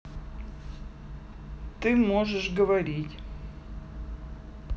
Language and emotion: Russian, neutral